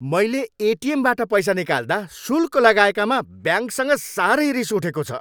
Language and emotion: Nepali, angry